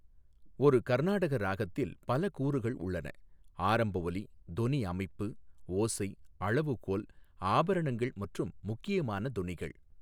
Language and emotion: Tamil, neutral